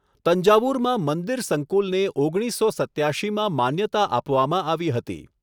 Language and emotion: Gujarati, neutral